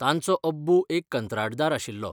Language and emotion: Goan Konkani, neutral